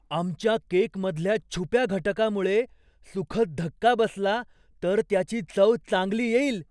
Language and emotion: Marathi, surprised